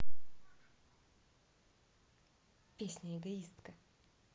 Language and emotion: Russian, neutral